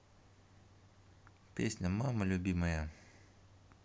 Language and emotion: Russian, neutral